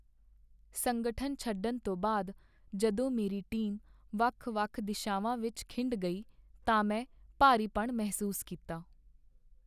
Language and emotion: Punjabi, sad